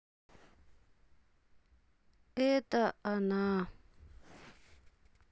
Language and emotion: Russian, sad